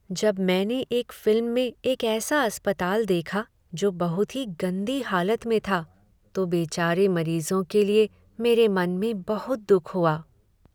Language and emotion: Hindi, sad